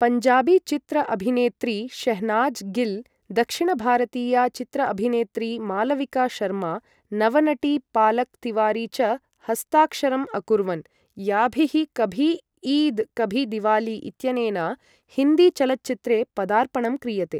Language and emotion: Sanskrit, neutral